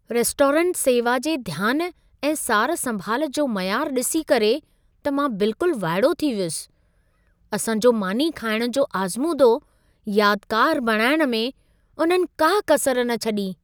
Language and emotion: Sindhi, surprised